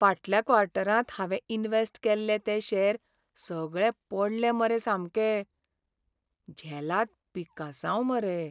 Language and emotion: Goan Konkani, sad